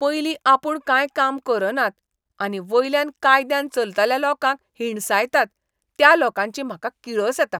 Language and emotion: Goan Konkani, disgusted